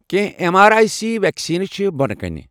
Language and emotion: Kashmiri, neutral